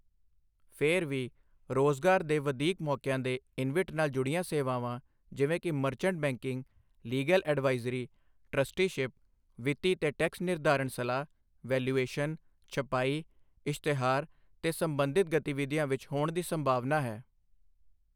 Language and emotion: Punjabi, neutral